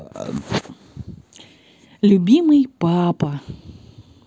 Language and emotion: Russian, positive